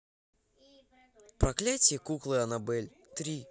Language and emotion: Russian, neutral